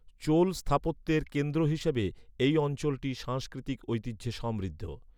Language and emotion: Bengali, neutral